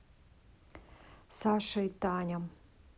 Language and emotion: Russian, neutral